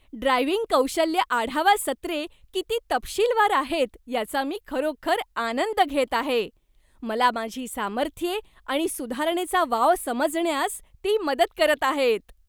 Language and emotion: Marathi, happy